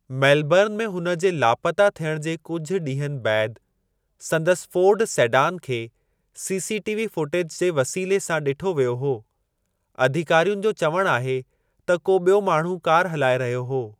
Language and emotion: Sindhi, neutral